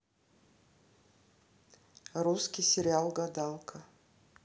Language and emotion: Russian, neutral